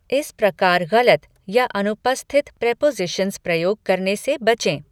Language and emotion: Hindi, neutral